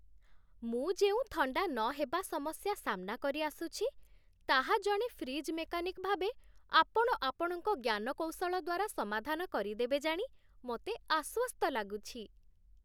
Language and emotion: Odia, happy